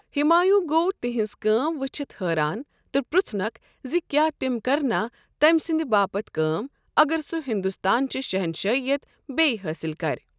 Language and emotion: Kashmiri, neutral